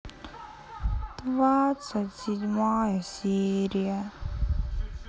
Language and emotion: Russian, sad